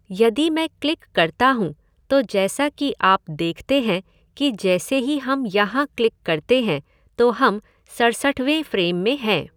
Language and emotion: Hindi, neutral